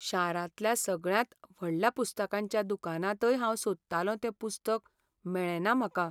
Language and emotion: Goan Konkani, sad